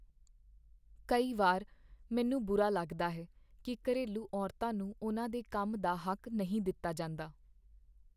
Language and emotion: Punjabi, sad